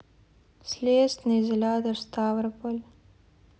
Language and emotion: Russian, sad